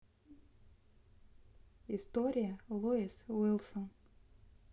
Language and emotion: Russian, neutral